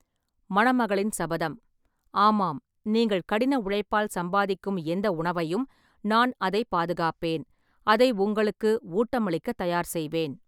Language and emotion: Tamil, neutral